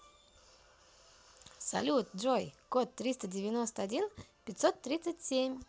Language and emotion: Russian, positive